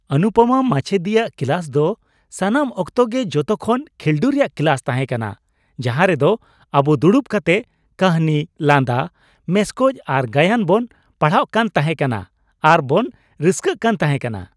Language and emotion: Santali, happy